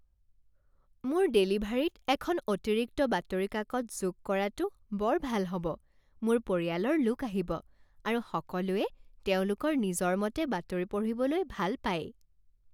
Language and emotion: Assamese, happy